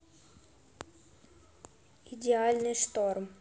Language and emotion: Russian, neutral